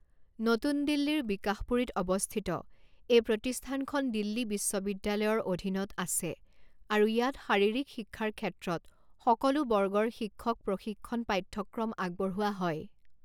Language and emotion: Assamese, neutral